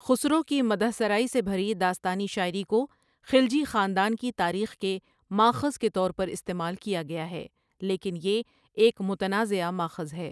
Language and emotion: Urdu, neutral